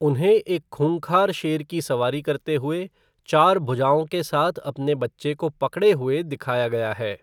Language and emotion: Hindi, neutral